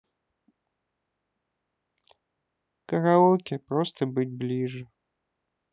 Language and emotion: Russian, sad